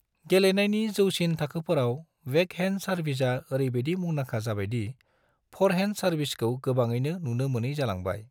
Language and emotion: Bodo, neutral